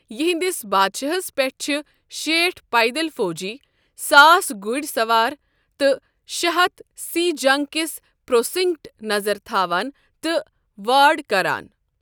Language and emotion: Kashmiri, neutral